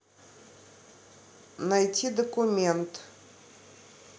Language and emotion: Russian, neutral